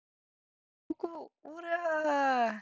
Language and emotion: Russian, positive